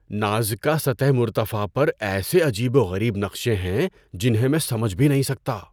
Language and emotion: Urdu, surprised